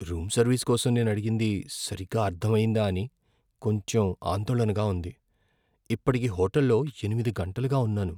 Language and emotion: Telugu, fearful